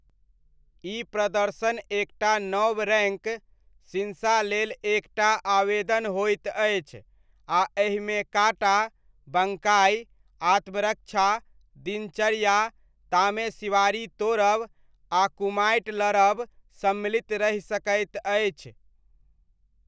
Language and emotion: Maithili, neutral